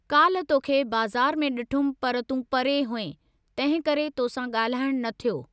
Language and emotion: Sindhi, neutral